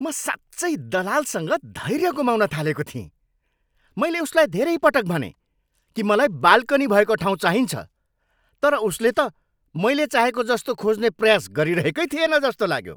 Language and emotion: Nepali, angry